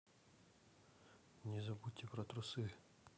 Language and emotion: Russian, neutral